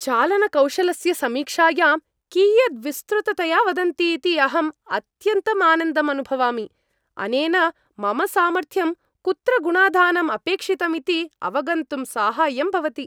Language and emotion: Sanskrit, happy